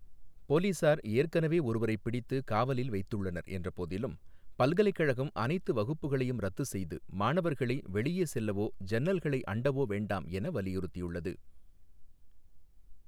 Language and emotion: Tamil, neutral